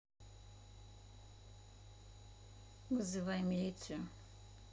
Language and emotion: Russian, neutral